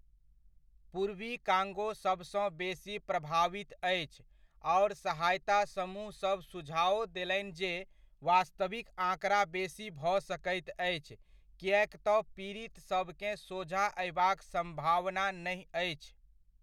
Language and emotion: Maithili, neutral